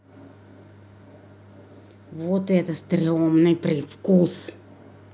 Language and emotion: Russian, angry